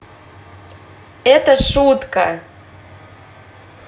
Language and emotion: Russian, positive